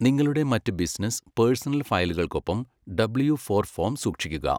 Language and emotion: Malayalam, neutral